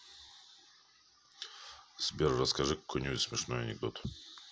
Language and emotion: Russian, neutral